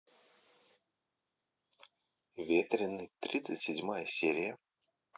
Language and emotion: Russian, neutral